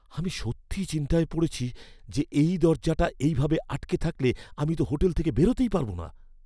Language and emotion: Bengali, fearful